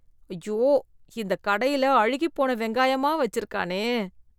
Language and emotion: Tamil, disgusted